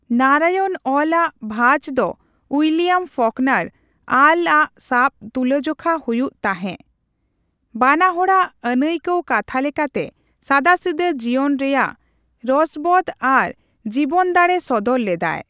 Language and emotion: Santali, neutral